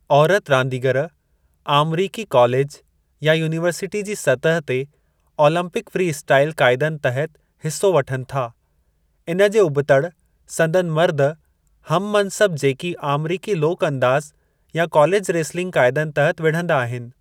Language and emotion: Sindhi, neutral